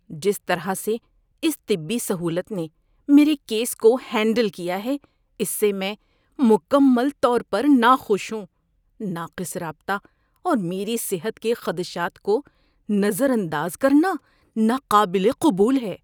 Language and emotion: Urdu, disgusted